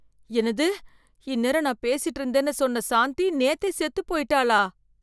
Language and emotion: Tamil, fearful